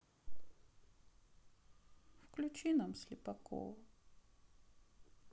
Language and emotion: Russian, sad